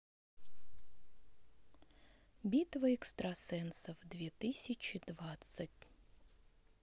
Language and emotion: Russian, neutral